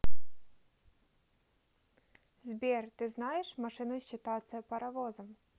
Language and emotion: Russian, neutral